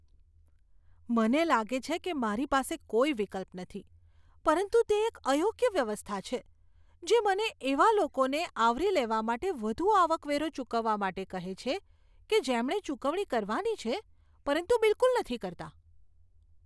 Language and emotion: Gujarati, disgusted